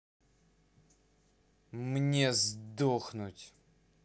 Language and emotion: Russian, angry